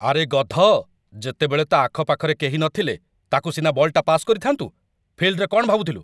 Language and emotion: Odia, angry